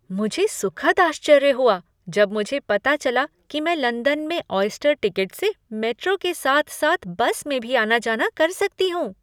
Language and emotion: Hindi, surprised